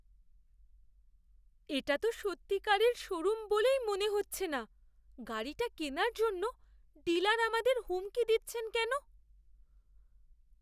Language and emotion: Bengali, fearful